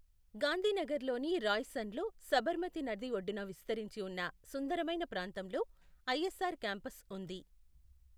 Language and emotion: Telugu, neutral